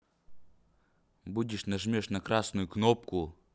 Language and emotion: Russian, neutral